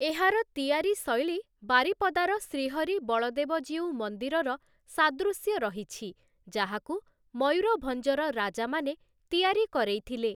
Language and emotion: Odia, neutral